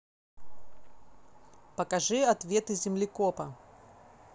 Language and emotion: Russian, neutral